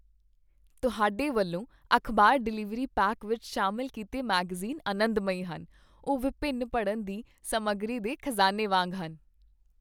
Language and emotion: Punjabi, happy